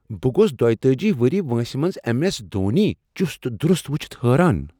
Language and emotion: Kashmiri, surprised